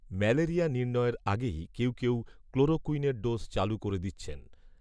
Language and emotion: Bengali, neutral